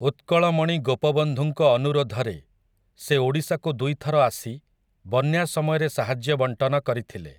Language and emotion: Odia, neutral